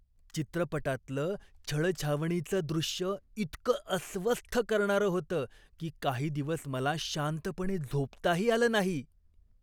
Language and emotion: Marathi, disgusted